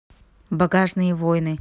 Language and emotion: Russian, neutral